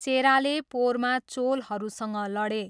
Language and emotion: Nepali, neutral